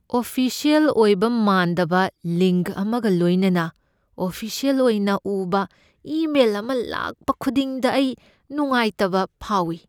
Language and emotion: Manipuri, fearful